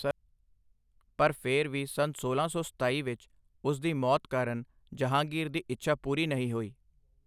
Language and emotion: Punjabi, neutral